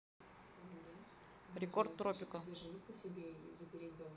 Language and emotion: Russian, neutral